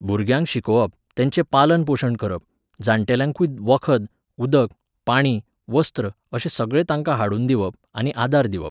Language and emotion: Goan Konkani, neutral